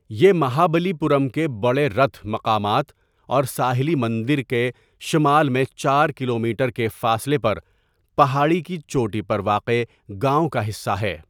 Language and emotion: Urdu, neutral